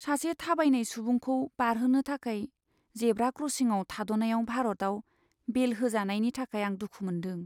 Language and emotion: Bodo, sad